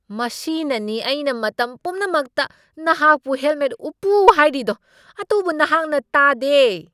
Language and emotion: Manipuri, angry